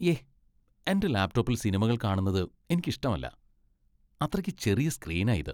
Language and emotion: Malayalam, disgusted